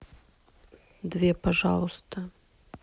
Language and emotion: Russian, neutral